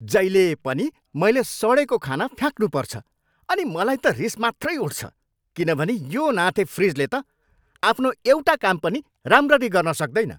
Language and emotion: Nepali, angry